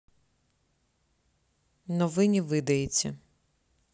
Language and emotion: Russian, neutral